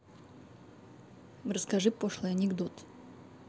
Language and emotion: Russian, neutral